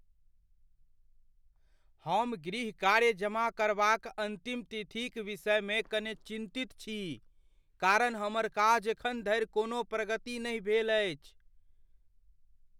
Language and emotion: Maithili, fearful